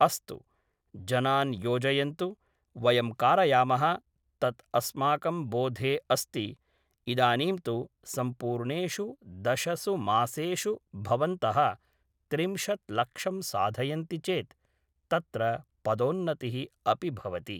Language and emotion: Sanskrit, neutral